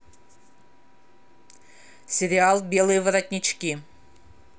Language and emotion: Russian, neutral